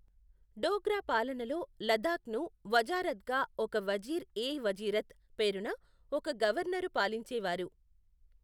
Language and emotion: Telugu, neutral